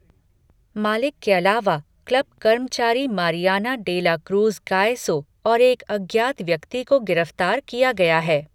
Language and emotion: Hindi, neutral